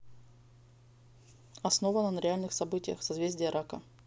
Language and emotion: Russian, neutral